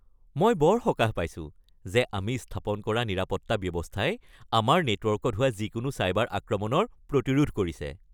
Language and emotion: Assamese, happy